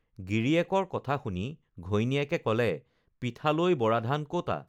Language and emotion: Assamese, neutral